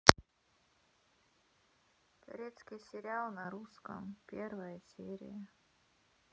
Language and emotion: Russian, sad